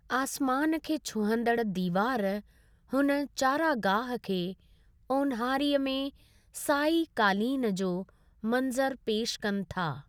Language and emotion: Sindhi, neutral